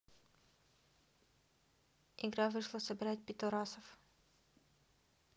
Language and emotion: Russian, neutral